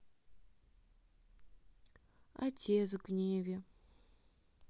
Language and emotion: Russian, sad